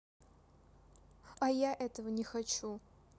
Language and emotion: Russian, sad